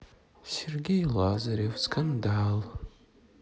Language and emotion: Russian, sad